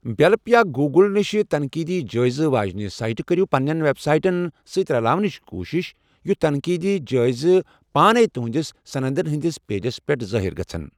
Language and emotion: Kashmiri, neutral